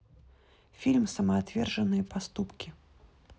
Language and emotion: Russian, neutral